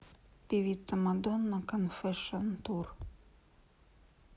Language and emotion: Russian, neutral